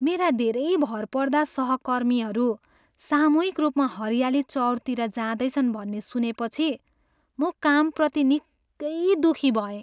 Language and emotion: Nepali, sad